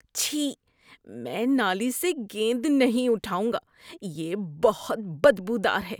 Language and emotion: Urdu, disgusted